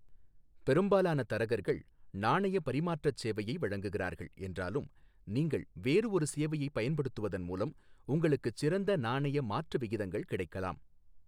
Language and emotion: Tamil, neutral